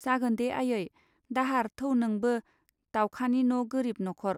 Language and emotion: Bodo, neutral